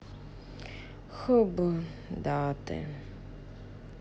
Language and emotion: Russian, sad